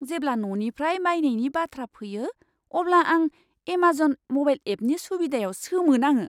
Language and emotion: Bodo, surprised